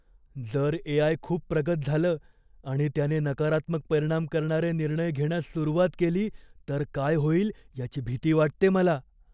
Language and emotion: Marathi, fearful